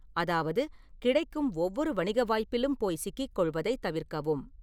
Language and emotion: Tamil, neutral